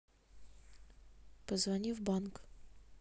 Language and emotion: Russian, neutral